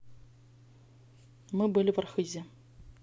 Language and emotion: Russian, neutral